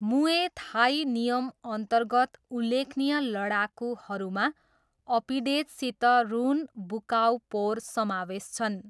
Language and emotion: Nepali, neutral